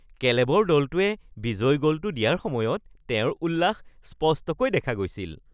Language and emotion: Assamese, happy